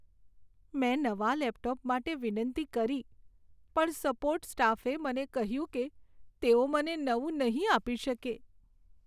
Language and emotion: Gujarati, sad